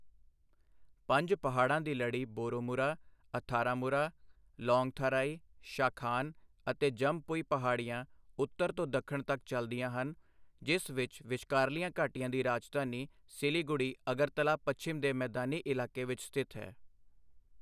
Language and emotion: Punjabi, neutral